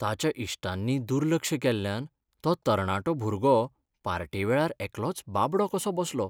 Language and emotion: Goan Konkani, sad